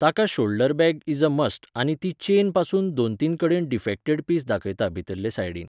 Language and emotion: Goan Konkani, neutral